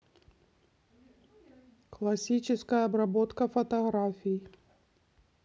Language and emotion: Russian, neutral